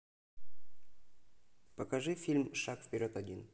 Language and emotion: Russian, neutral